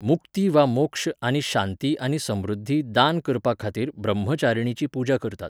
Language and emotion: Goan Konkani, neutral